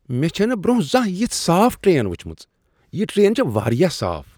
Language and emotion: Kashmiri, surprised